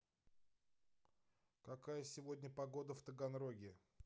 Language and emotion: Russian, neutral